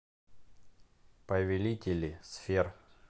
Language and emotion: Russian, neutral